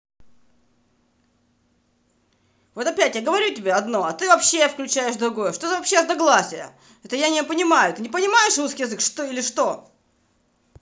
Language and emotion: Russian, angry